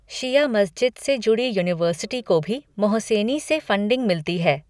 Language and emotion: Hindi, neutral